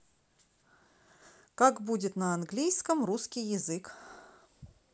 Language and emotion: Russian, neutral